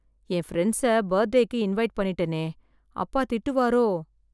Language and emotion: Tamil, fearful